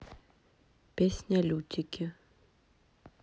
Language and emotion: Russian, neutral